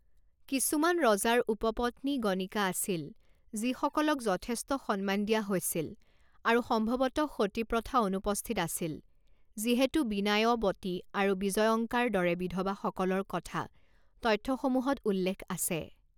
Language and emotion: Assamese, neutral